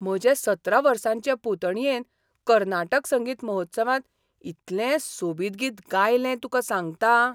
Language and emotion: Goan Konkani, surprised